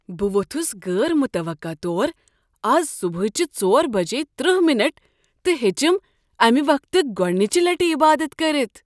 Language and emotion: Kashmiri, surprised